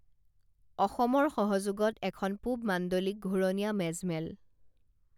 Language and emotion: Assamese, neutral